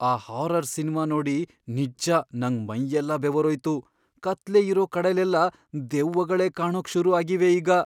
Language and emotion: Kannada, fearful